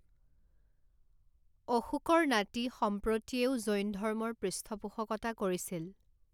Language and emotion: Assamese, neutral